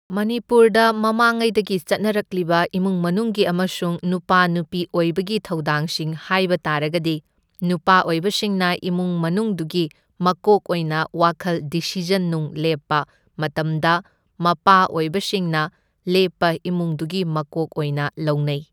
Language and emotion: Manipuri, neutral